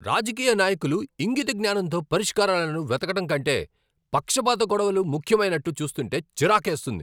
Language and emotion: Telugu, angry